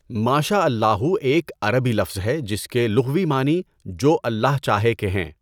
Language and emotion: Urdu, neutral